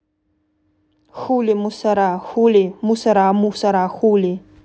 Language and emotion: Russian, neutral